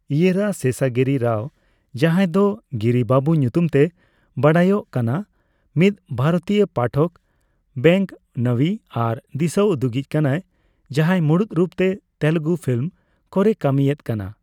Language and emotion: Santali, neutral